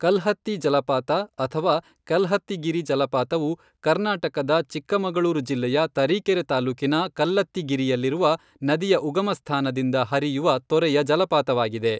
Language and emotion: Kannada, neutral